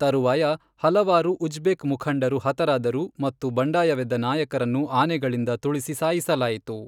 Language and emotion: Kannada, neutral